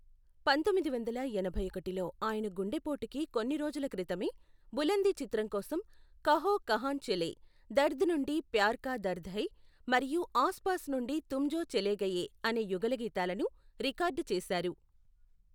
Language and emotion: Telugu, neutral